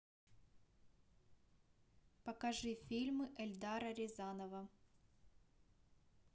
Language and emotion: Russian, neutral